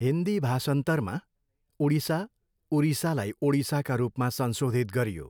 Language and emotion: Nepali, neutral